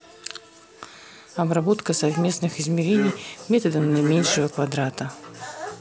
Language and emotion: Russian, neutral